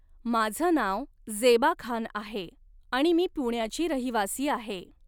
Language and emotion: Marathi, neutral